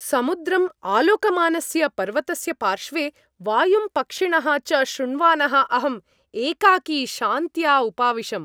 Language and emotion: Sanskrit, happy